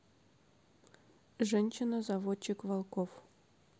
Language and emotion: Russian, neutral